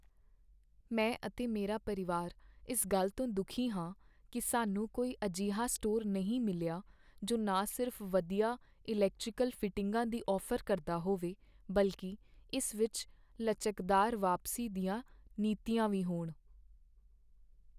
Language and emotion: Punjabi, sad